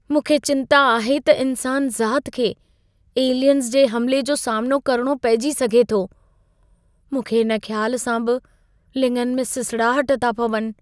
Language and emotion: Sindhi, fearful